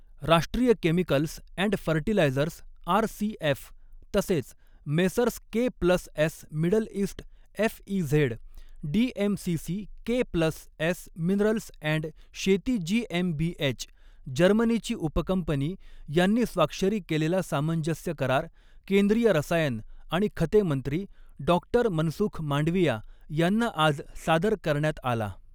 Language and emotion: Marathi, neutral